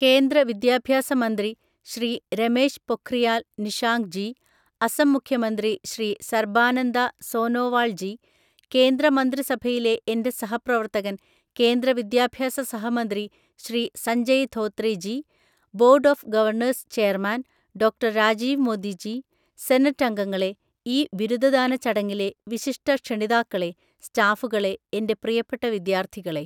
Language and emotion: Malayalam, neutral